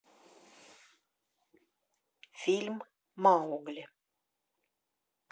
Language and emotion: Russian, neutral